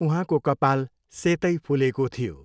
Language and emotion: Nepali, neutral